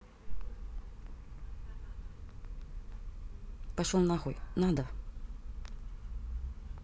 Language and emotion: Russian, angry